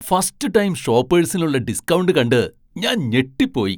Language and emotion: Malayalam, surprised